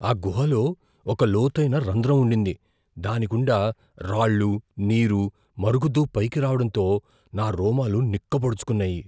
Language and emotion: Telugu, fearful